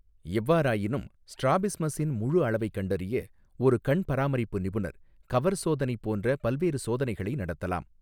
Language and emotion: Tamil, neutral